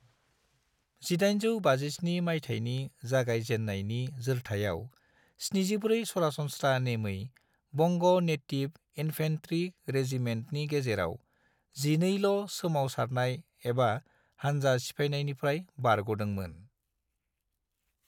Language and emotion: Bodo, neutral